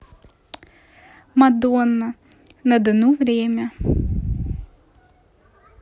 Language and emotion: Russian, neutral